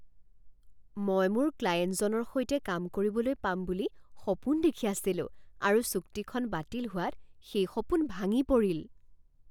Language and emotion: Assamese, surprised